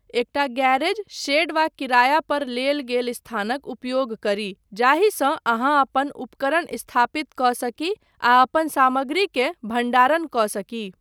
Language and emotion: Maithili, neutral